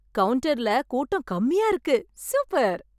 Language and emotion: Tamil, happy